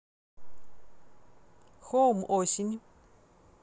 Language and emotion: Russian, neutral